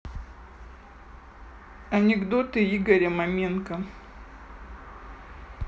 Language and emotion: Russian, neutral